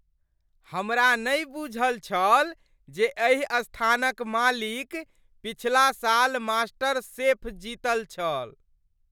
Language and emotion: Maithili, surprised